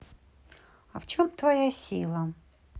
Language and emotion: Russian, neutral